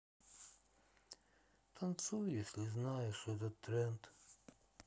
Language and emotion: Russian, sad